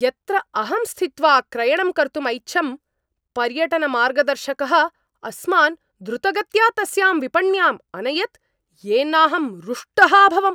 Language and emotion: Sanskrit, angry